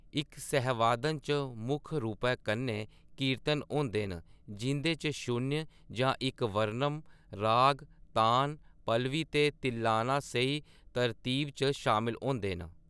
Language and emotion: Dogri, neutral